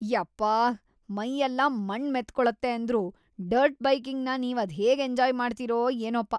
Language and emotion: Kannada, disgusted